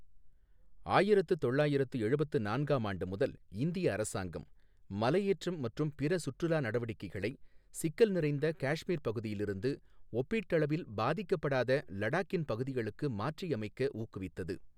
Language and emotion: Tamil, neutral